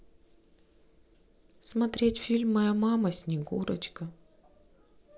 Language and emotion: Russian, sad